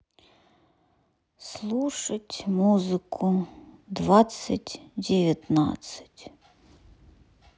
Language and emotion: Russian, sad